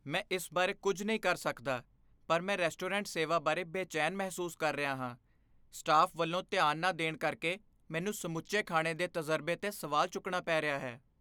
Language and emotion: Punjabi, fearful